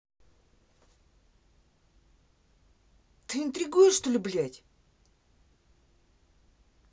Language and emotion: Russian, angry